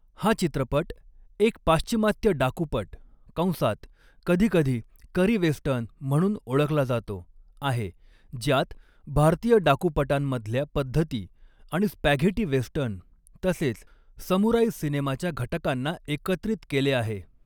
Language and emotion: Marathi, neutral